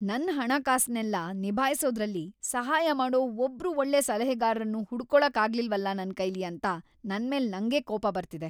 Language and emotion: Kannada, angry